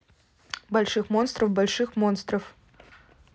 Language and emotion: Russian, neutral